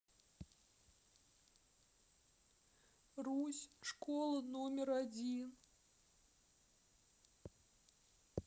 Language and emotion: Russian, sad